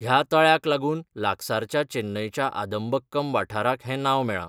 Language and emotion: Goan Konkani, neutral